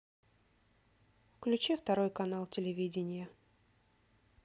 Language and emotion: Russian, neutral